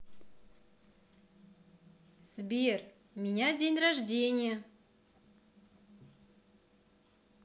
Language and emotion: Russian, positive